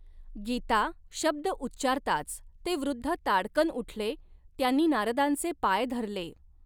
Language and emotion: Marathi, neutral